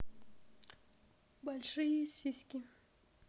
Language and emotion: Russian, neutral